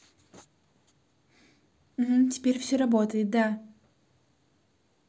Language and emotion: Russian, neutral